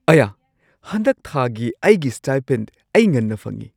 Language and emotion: Manipuri, surprised